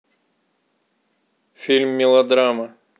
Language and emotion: Russian, neutral